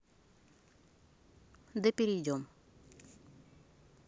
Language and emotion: Russian, neutral